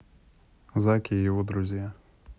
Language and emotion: Russian, neutral